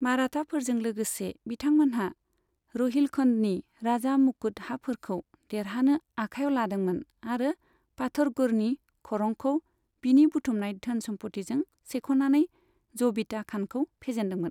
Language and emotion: Bodo, neutral